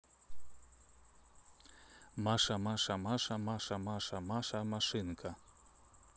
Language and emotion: Russian, neutral